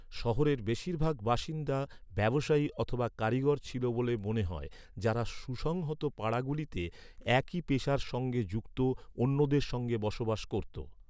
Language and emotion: Bengali, neutral